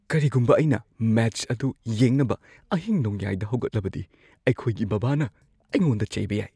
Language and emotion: Manipuri, fearful